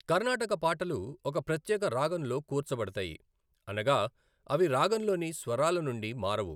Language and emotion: Telugu, neutral